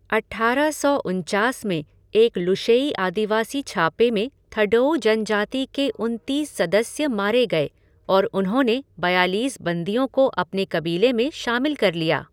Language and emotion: Hindi, neutral